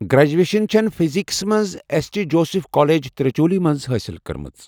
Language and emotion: Kashmiri, neutral